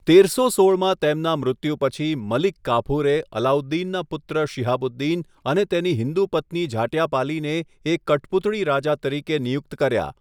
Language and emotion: Gujarati, neutral